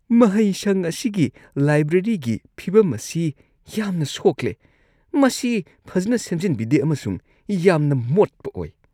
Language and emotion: Manipuri, disgusted